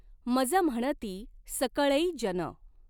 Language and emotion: Marathi, neutral